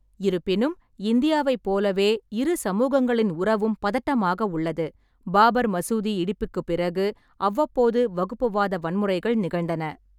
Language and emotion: Tamil, neutral